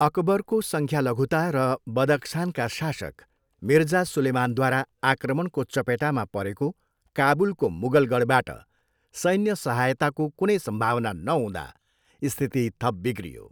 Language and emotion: Nepali, neutral